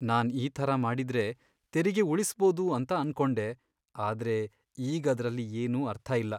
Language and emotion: Kannada, sad